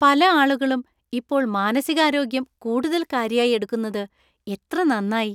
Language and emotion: Malayalam, happy